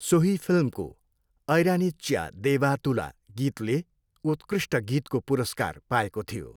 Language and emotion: Nepali, neutral